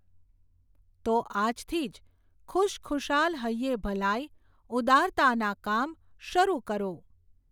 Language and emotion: Gujarati, neutral